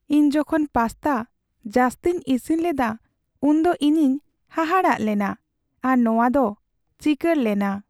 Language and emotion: Santali, sad